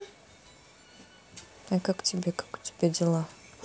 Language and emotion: Russian, neutral